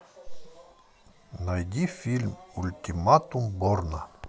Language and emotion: Russian, neutral